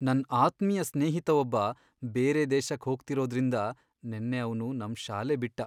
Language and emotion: Kannada, sad